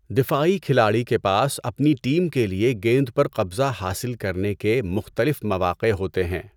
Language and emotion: Urdu, neutral